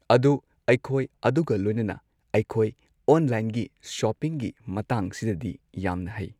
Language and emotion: Manipuri, neutral